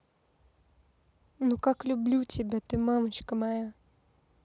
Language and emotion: Russian, neutral